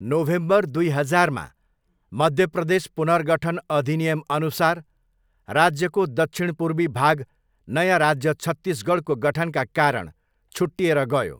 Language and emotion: Nepali, neutral